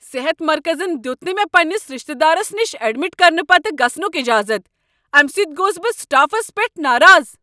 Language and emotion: Kashmiri, angry